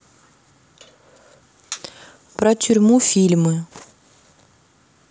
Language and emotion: Russian, neutral